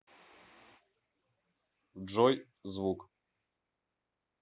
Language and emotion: Russian, neutral